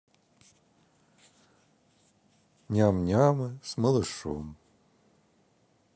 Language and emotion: Russian, sad